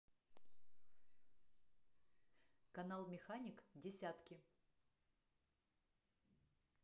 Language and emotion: Russian, neutral